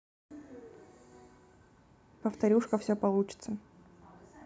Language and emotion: Russian, neutral